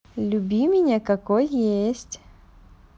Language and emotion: Russian, positive